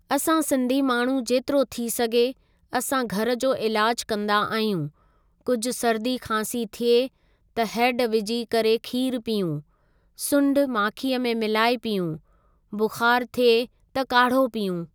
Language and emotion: Sindhi, neutral